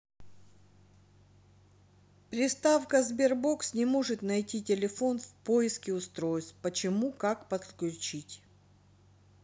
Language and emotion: Russian, neutral